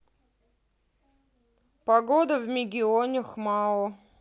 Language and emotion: Russian, neutral